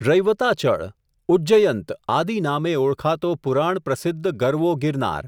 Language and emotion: Gujarati, neutral